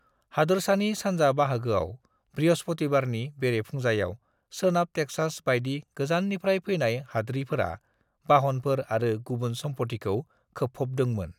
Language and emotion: Bodo, neutral